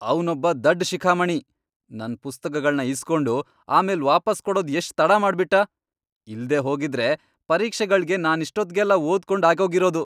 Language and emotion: Kannada, angry